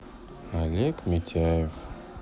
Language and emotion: Russian, sad